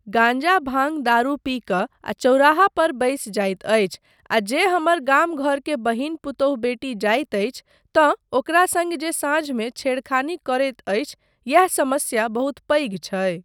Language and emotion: Maithili, neutral